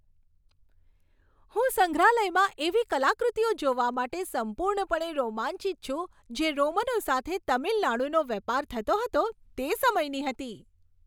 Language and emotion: Gujarati, happy